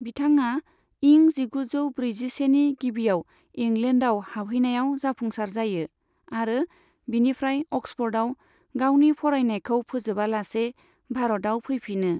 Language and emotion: Bodo, neutral